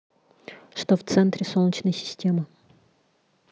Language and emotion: Russian, neutral